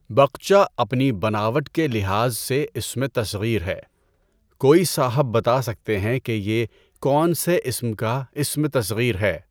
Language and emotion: Urdu, neutral